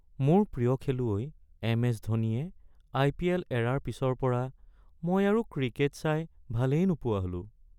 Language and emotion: Assamese, sad